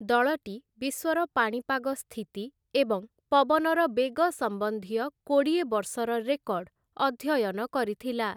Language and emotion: Odia, neutral